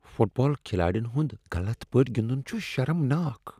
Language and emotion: Kashmiri, disgusted